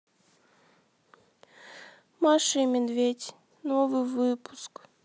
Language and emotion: Russian, sad